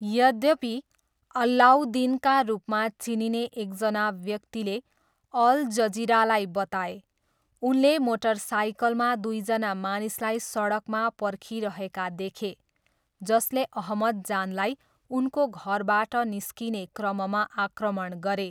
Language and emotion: Nepali, neutral